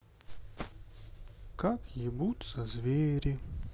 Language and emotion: Russian, sad